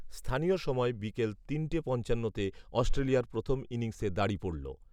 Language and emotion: Bengali, neutral